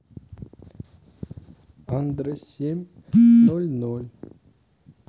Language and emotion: Russian, sad